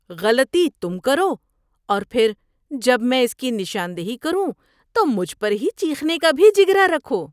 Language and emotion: Urdu, disgusted